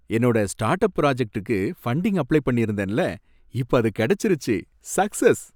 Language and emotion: Tamil, happy